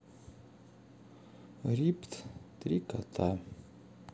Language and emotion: Russian, sad